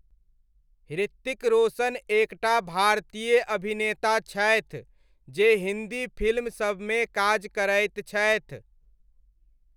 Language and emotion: Maithili, neutral